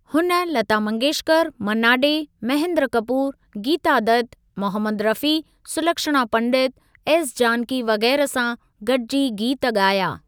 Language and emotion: Sindhi, neutral